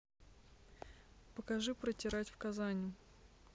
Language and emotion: Russian, neutral